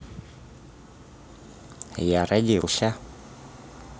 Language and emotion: Russian, positive